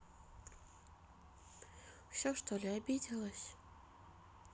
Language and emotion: Russian, sad